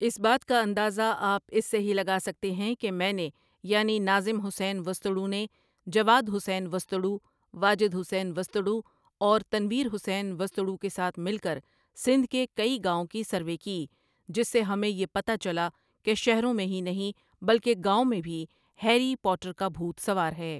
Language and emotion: Urdu, neutral